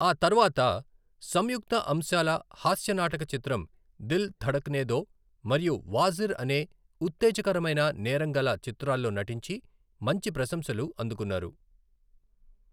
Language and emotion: Telugu, neutral